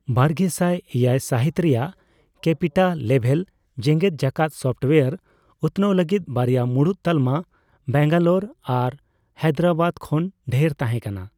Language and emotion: Santali, neutral